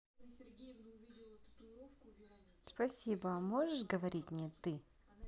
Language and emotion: Russian, positive